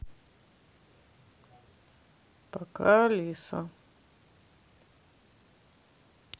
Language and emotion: Russian, sad